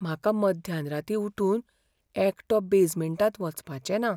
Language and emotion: Goan Konkani, fearful